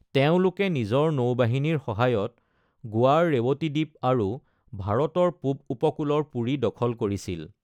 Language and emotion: Assamese, neutral